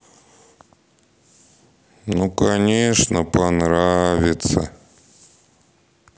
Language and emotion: Russian, sad